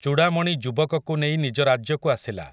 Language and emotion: Odia, neutral